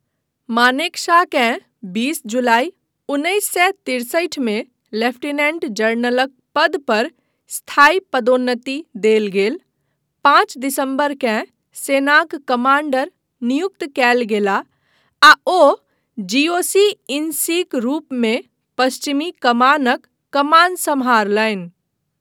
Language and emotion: Maithili, neutral